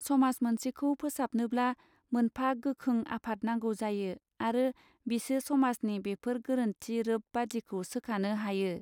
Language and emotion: Bodo, neutral